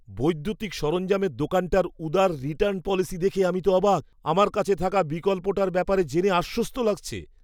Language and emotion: Bengali, surprised